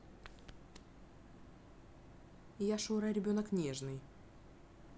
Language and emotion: Russian, neutral